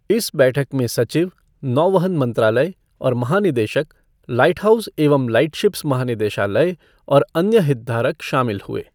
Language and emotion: Hindi, neutral